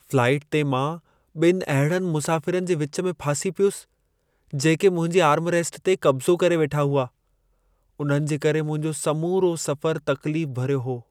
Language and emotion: Sindhi, sad